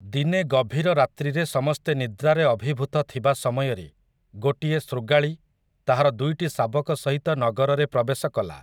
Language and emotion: Odia, neutral